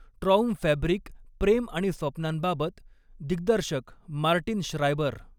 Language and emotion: Marathi, neutral